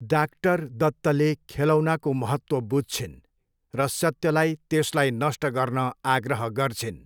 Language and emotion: Nepali, neutral